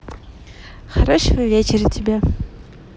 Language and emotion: Russian, positive